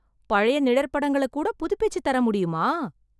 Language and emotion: Tamil, surprised